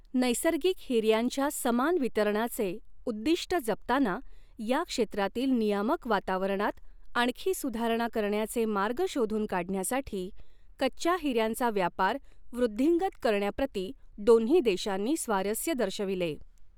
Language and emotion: Marathi, neutral